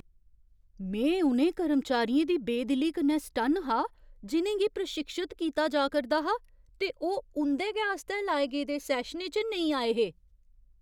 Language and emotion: Dogri, surprised